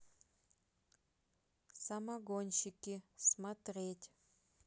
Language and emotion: Russian, neutral